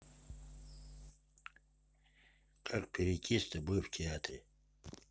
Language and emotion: Russian, neutral